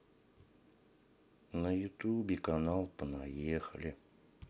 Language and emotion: Russian, sad